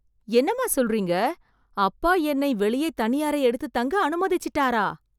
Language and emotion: Tamil, surprised